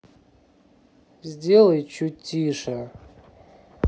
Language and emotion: Russian, angry